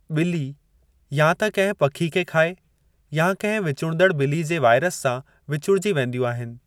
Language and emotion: Sindhi, neutral